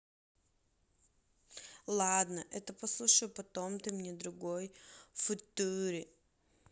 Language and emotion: Russian, neutral